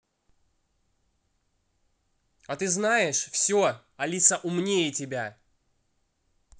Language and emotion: Russian, angry